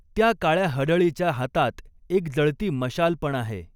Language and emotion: Marathi, neutral